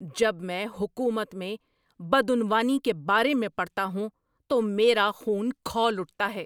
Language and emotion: Urdu, angry